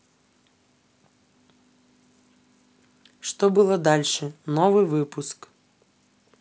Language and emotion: Russian, neutral